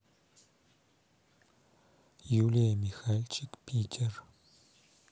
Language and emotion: Russian, neutral